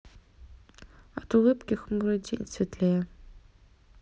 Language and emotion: Russian, neutral